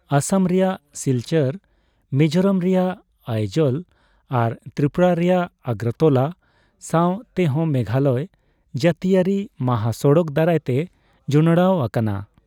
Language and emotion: Santali, neutral